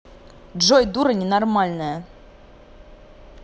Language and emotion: Russian, angry